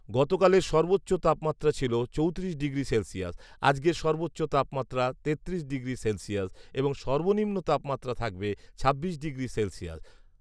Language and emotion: Bengali, neutral